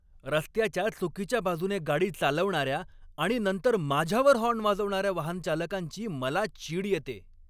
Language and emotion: Marathi, angry